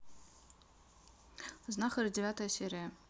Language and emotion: Russian, neutral